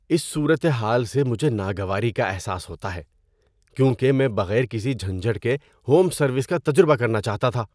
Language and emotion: Urdu, disgusted